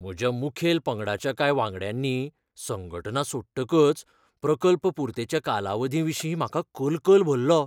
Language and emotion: Goan Konkani, fearful